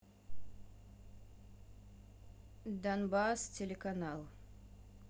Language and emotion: Russian, neutral